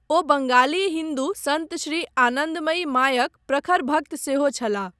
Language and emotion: Maithili, neutral